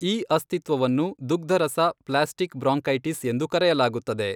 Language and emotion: Kannada, neutral